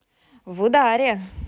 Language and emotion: Russian, positive